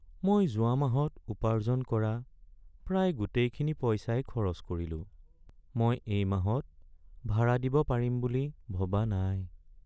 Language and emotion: Assamese, sad